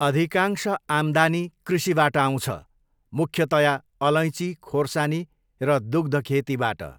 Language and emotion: Nepali, neutral